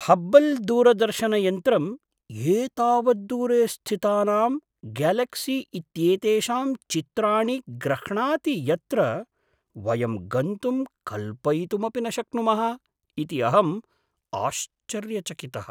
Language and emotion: Sanskrit, surprised